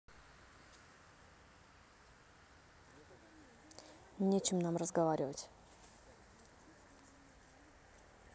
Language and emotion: Russian, angry